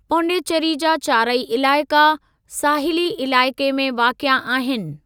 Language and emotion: Sindhi, neutral